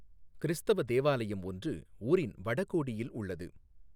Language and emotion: Tamil, neutral